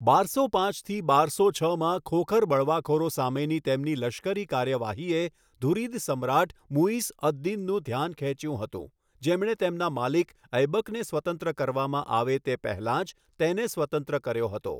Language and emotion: Gujarati, neutral